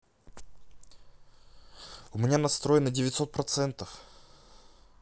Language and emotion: Russian, neutral